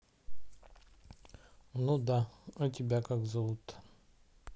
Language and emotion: Russian, neutral